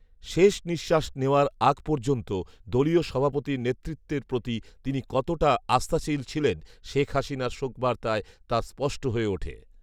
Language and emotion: Bengali, neutral